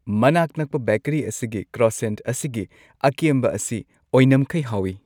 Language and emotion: Manipuri, happy